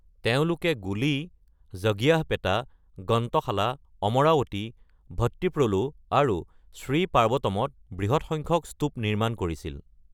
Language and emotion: Assamese, neutral